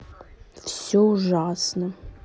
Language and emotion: Russian, sad